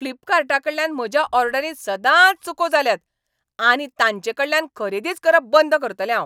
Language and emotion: Goan Konkani, angry